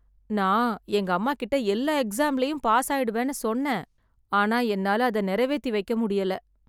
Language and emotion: Tamil, sad